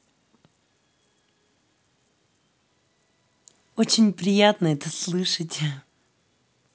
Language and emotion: Russian, positive